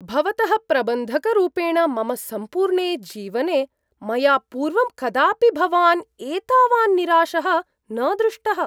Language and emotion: Sanskrit, surprised